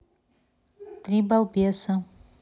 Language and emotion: Russian, neutral